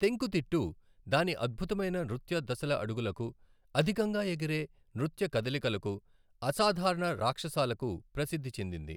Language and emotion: Telugu, neutral